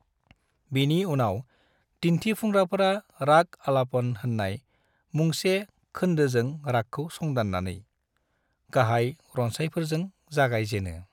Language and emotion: Bodo, neutral